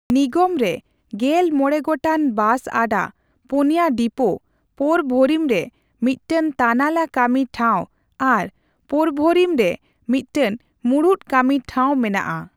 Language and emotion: Santali, neutral